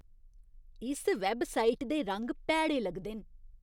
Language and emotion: Dogri, disgusted